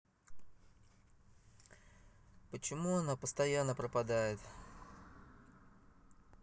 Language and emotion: Russian, sad